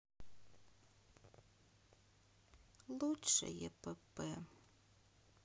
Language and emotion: Russian, sad